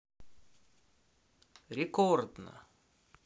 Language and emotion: Russian, positive